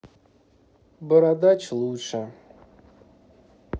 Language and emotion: Russian, neutral